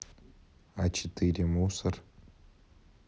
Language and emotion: Russian, neutral